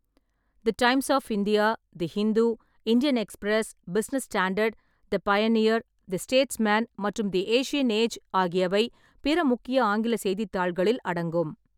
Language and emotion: Tamil, neutral